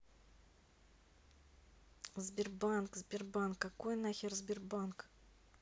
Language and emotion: Russian, neutral